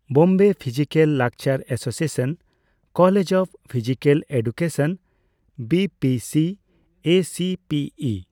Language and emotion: Santali, neutral